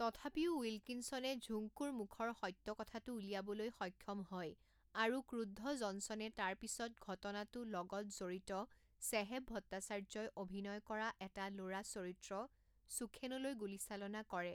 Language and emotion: Assamese, neutral